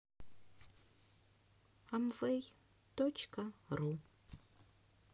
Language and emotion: Russian, sad